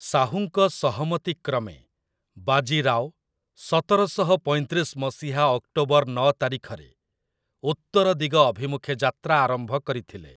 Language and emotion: Odia, neutral